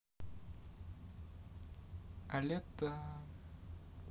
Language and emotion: Russian, neutral